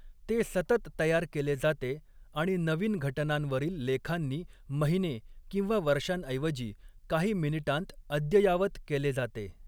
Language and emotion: Marathi, neutral